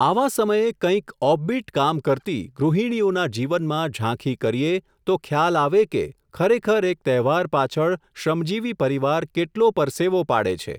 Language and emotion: Gujarati, neutral